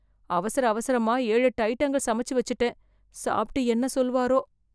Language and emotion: Tamil, fearful